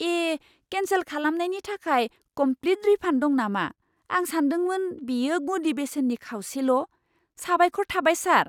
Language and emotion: Bodo, surprised